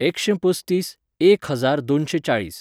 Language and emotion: Goan Konkani, neutral